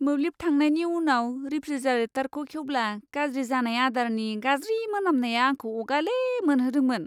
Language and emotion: Bodo, disgusted